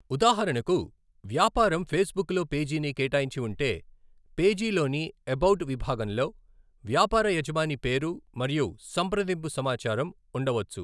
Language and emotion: Telugu, neutral